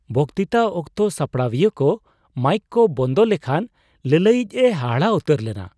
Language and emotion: Santali, surprised